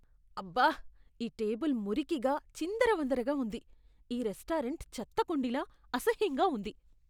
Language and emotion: Telugu, disgusted